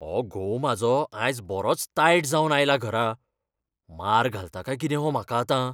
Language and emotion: Goan Konkani, fearful